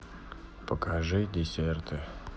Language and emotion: Russian, neutral